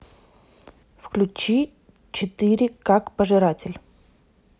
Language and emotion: Russian, neutral